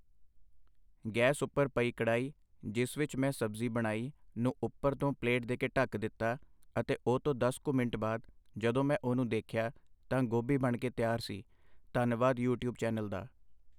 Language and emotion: Punjabi, neutral